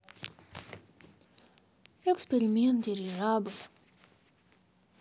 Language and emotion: Russian, sad